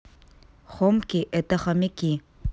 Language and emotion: Russian, neutral